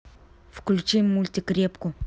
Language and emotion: Russian, angry